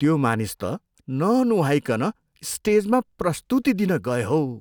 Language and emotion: Nepali, disgusted